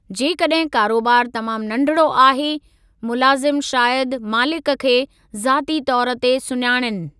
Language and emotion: Sindhi, neutral